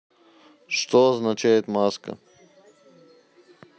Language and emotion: Russian, neutral